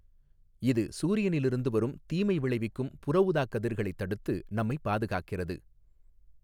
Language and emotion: Tamil, neutral